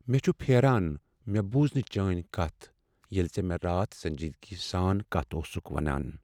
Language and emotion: Kashmiri, sad